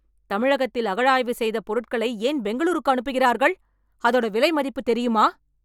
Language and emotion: Tamil, angry